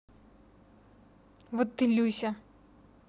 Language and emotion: Russian, neutral